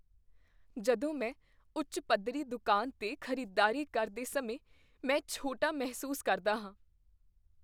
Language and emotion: Punjabi, fearful